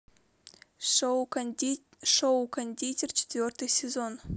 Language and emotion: Russian, neutral